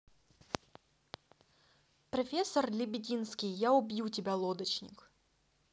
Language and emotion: Russian, neutral